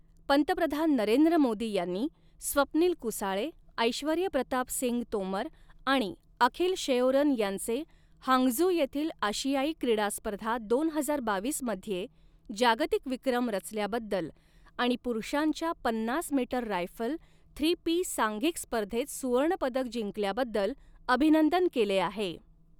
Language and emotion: Marathi, neutral